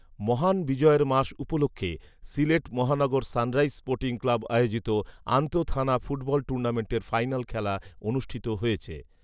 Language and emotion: Bengali, neutral